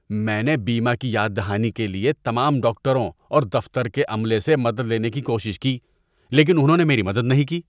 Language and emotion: Urdu, disgusted